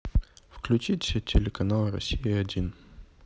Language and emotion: Russian, neutral